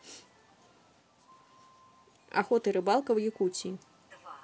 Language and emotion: Russian, neutral